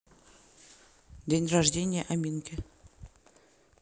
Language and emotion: Russian, neutral